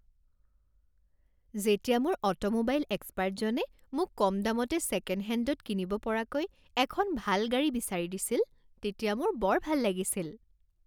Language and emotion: Assamese, happy